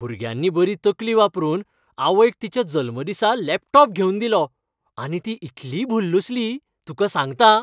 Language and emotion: Goan Konkani, happy